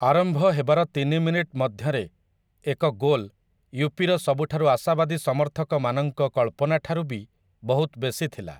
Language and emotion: Odia, neutral